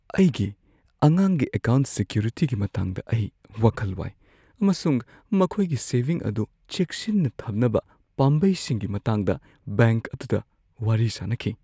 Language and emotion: Manipuri, fearful